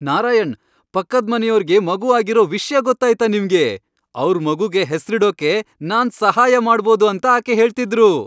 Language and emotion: Kannada, happy